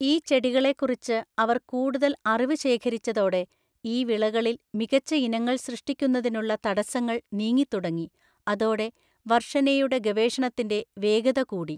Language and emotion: Malayalam, neutral